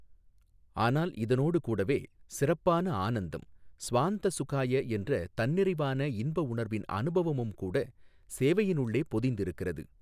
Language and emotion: Tamil, neutral